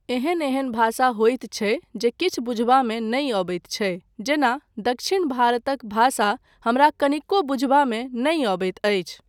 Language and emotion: Maithili, neutral